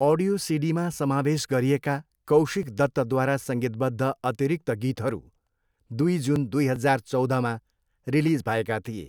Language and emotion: Nepali, neutral